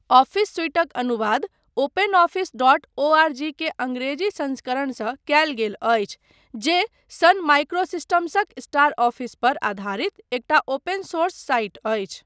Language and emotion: Maithili, neutral